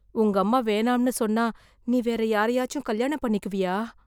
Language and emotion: Tamil, fearful